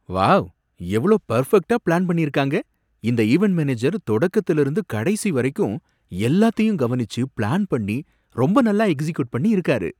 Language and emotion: Tamil, surprised